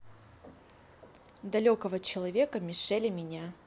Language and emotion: Russian, neutral